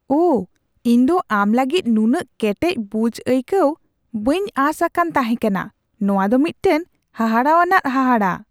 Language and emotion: Santali, surprised